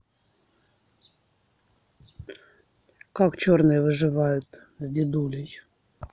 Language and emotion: Russian, neutral